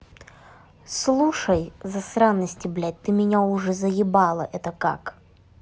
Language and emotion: Russian, angry